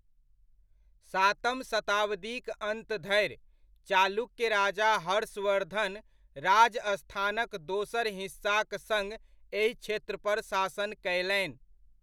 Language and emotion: Maithili, neutral